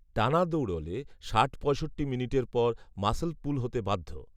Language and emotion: Bengali, neutral